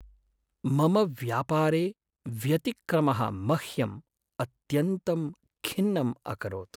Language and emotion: Sanskrit, sad